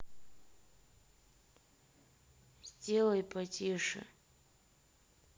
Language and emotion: Russian, sad